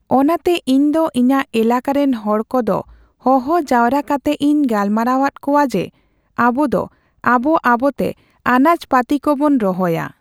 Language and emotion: Santali, neutral